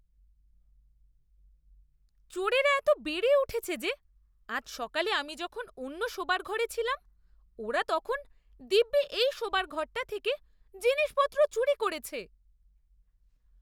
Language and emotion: Bengali, disgusted